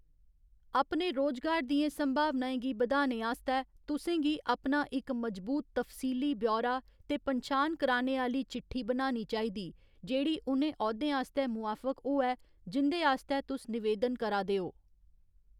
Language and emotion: Dogri, neutral